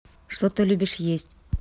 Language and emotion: Russian, neutral